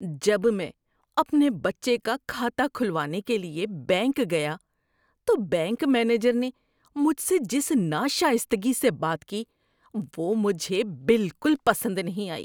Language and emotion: Urdu, disgusted